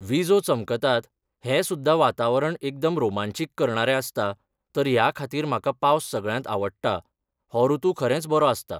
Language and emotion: Goan Konkani, neutral